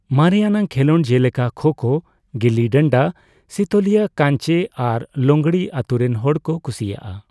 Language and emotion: Santali, neutral